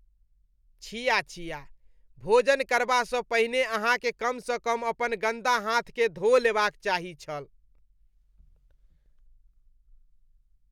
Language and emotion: Maithili, disgusted